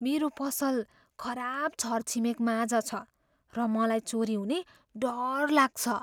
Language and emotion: Nepali, fearful